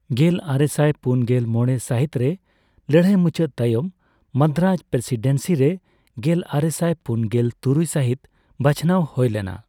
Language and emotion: Santali, neutral